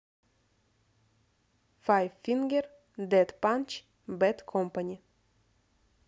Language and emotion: Russian, neutral